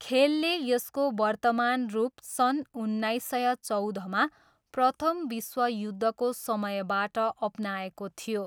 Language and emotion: Nepali, neutral